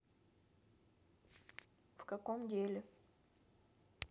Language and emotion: Russian, neutral